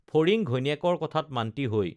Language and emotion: Assamese, neutral